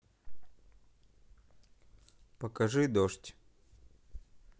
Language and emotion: Russian, neutral